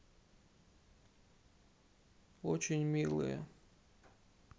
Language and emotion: Russian, sad